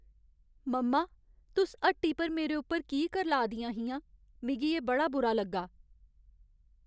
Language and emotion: Dogri, sad